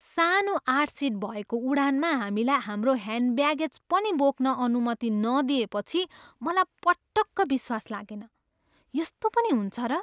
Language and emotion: Nepali, surprised